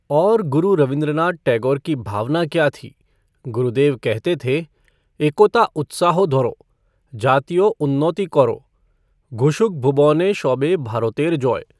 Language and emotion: Hindi, neutral